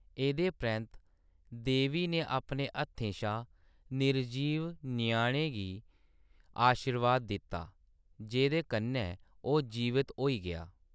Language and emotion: Dogri, neutral